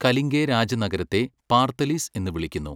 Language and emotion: Malayalam, neutral